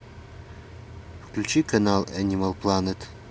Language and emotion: Russian, neutral